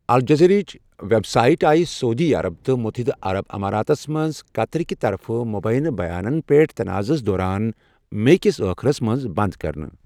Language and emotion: Kashmiri, neutral